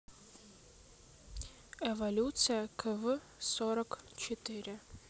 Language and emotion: Russian, neutral